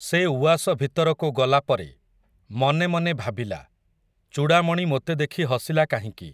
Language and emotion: Odia, neutral